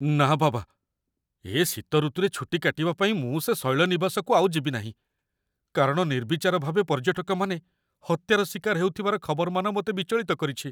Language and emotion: Odia, fearful